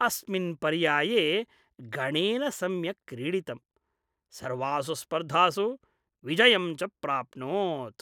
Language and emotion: Sanskrit, happy